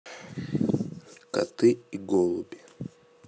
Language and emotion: Russian, neutral